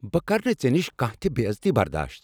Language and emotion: Kashmiri, angry